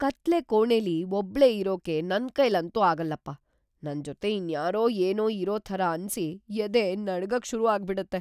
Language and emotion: Kannada, fearful